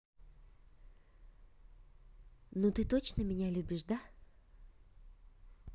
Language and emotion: Russian, neutral